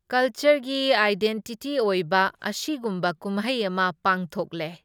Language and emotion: Manipuri, neutral